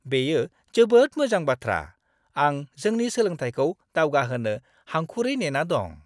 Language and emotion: Bodo, happy